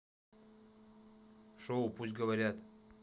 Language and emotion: Russian, neutral